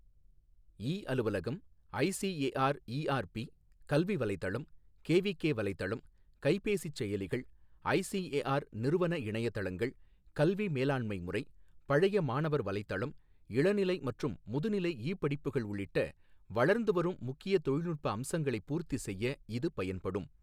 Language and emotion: Tamil, neutral